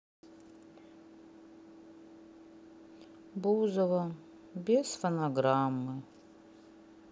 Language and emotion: Russian, sad